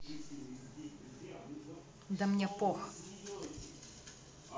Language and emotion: Russian, angry